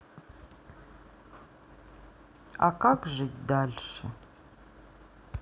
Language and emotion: Russian, sad